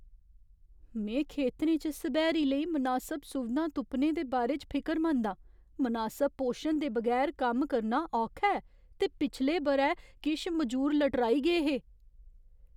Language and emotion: Dogri, fearful